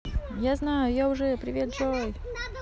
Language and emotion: Russian, neutral